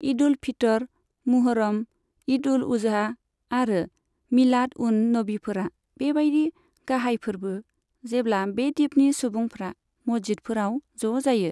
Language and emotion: Bodo, neutral